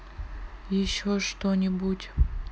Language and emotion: Russian, sad